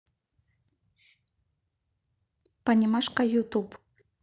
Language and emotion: Russian, neutral